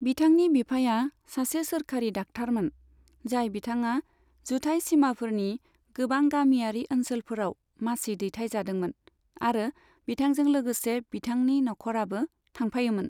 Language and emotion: Bodo, neutral